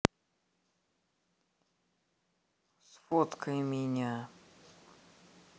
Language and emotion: Russian, neutral